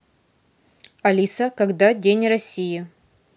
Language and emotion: Russian, neutral